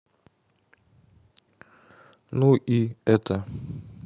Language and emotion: Russian, neutral